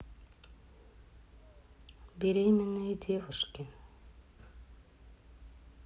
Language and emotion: Russian, neutral